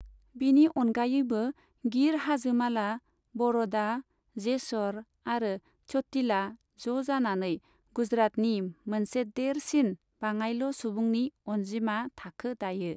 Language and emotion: Bodo, neutral